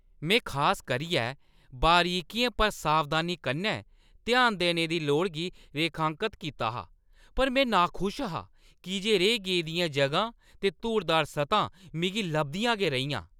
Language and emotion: Dogri, angry